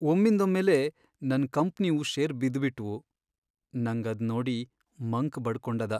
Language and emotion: Kannada, sad